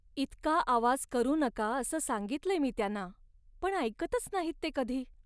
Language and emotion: Marathi, sad